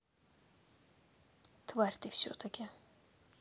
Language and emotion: Russian, angry